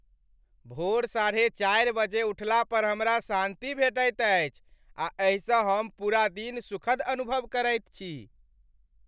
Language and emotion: Maithili, happy